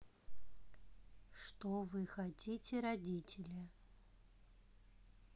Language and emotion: Russian, neutral